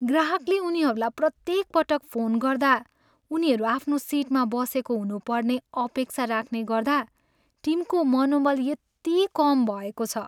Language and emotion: Nepali, sad